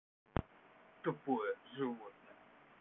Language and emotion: Russian, angry